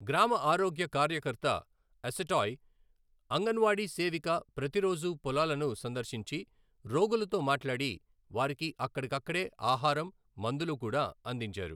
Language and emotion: Telugu, neutral